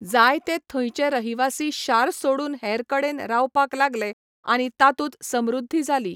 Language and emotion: Goan Konkani, neutral